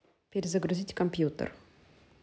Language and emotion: Russian, neutral